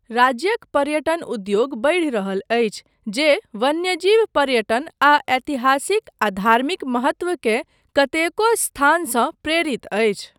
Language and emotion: Maithili, neutral